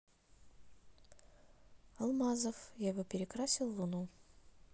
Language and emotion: Russian, neutral